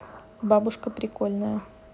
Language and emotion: Russian, neutral